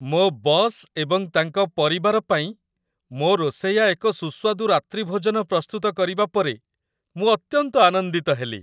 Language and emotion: Odia, happy